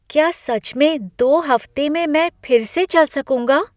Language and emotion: Hindi, surprised